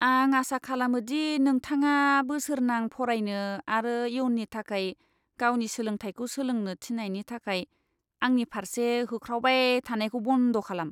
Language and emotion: Bodo, disgusted